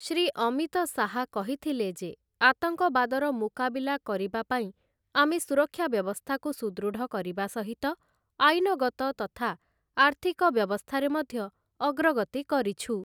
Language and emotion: Odia, neutral